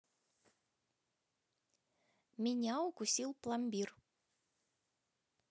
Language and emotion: Russian, neutral